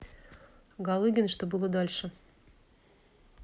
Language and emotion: Russian, neutral